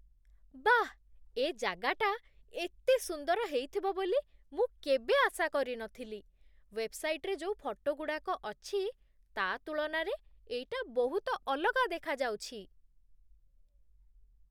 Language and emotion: Odia, surprised